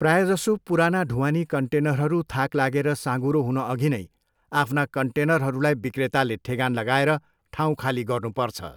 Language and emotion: Nepali, neutral